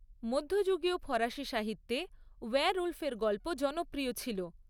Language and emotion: Bengali, neutral